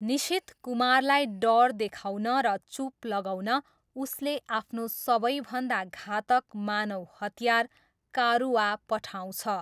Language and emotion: Nepali, neutral